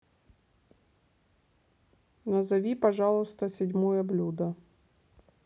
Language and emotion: Russian, neutral